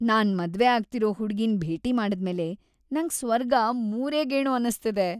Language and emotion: Kannada, happy